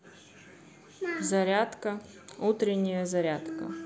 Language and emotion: Russian, neutral